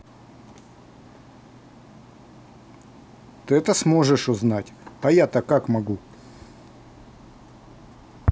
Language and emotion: Russian, neutral